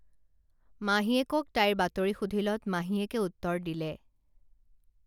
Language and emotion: Assamese, neutral